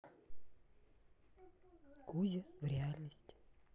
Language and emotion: Russian, neutral